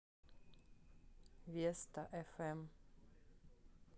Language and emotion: Russian, neutral